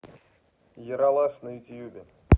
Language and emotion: Russian, neutral